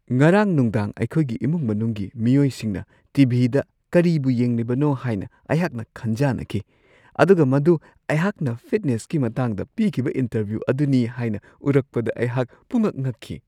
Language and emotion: Manipuri, surprised